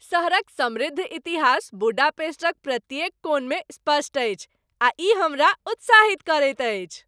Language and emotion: Maithili, happy